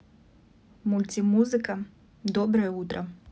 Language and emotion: Russian, neutral